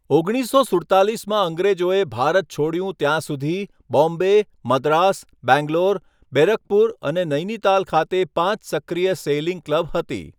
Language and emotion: Gujarati, neutral